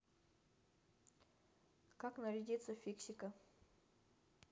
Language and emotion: Russian, neutral